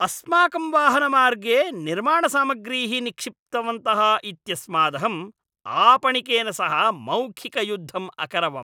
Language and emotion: Sanskrit, angry